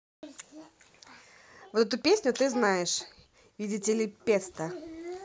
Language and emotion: Russian, neutral